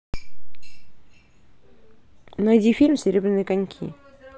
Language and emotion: Russian, neutral